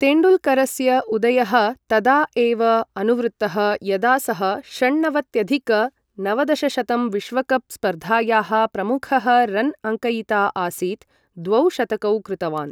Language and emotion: Sanskrit, neutral